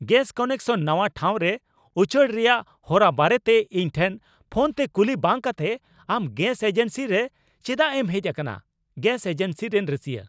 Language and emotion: Santali, angry